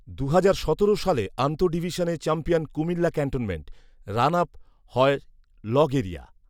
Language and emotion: Bengali, neutral